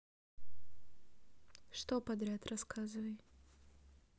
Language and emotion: Russian, neutral